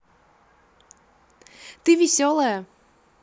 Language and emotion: Russian, positive